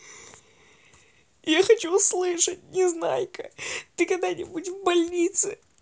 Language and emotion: Russian, sad